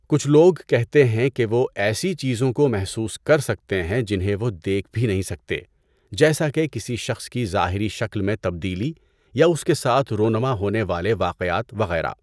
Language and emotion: Urdu, neutral